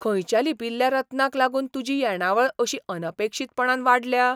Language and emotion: Goan Konkani, surprised